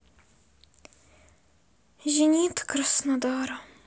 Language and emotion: Russian, sad